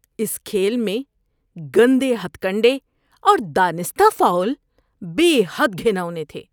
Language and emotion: Urdu, disgusted